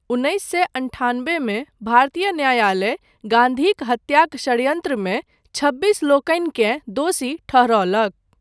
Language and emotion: Maithili, neutral